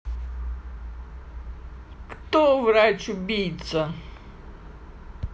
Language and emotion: Russian, sad